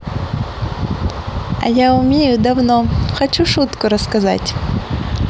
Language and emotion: Russian, positive